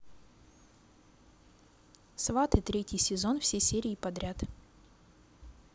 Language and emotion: Russian, neutral